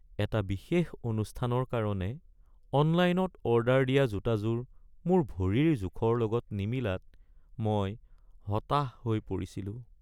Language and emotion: Assamese, sad